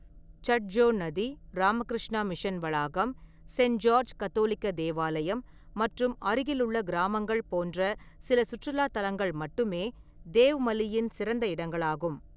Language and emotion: Tamil, neutral